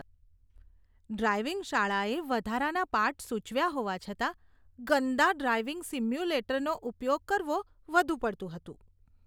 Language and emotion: Gujarati, disgusted